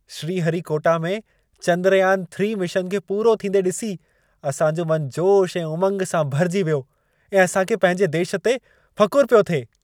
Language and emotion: Sindhi, happy